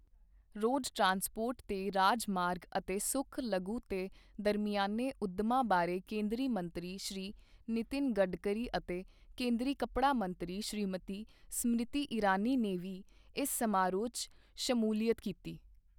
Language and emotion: Punjabi, neutral